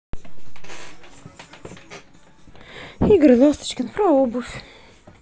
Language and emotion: Russian, neutral